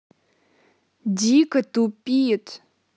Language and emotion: Russian, angry